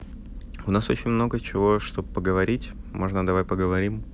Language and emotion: Russian, neutral